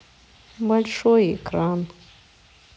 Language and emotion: Russian, sad